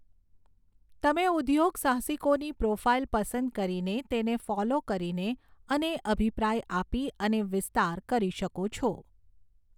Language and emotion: Gujarati, neutral